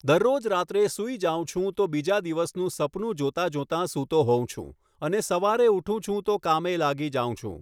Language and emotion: Gujarati, neutral